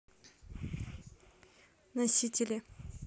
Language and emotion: Russian, neutral